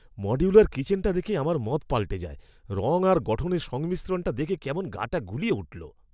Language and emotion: Bengali, disgusted